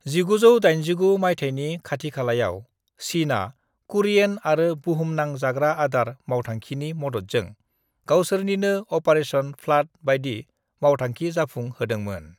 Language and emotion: Bodo, neutral